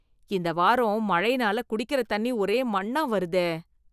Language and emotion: Tamil, disgusted